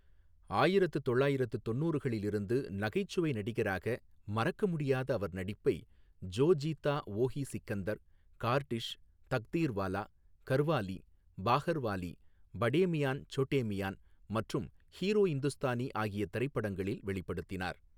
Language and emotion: Tamil, neutral